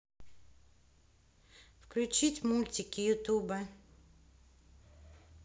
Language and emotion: Russian, neutral